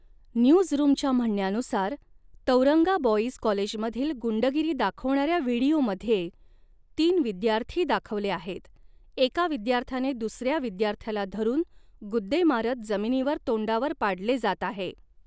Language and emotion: Marathi, neutral